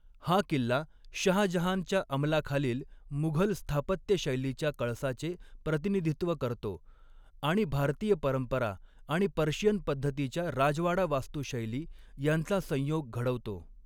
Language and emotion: Marathi, neutral